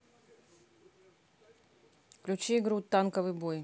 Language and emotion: Russian, neutral